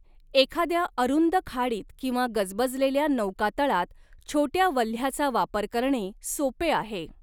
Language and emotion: Marathi, neutral